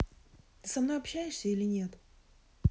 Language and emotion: Russian, neutral